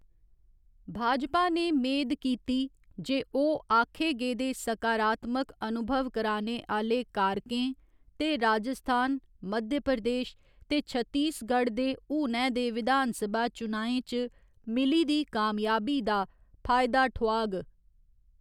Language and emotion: Dogri, neutral